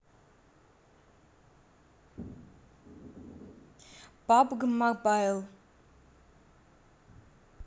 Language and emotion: Russian, neutral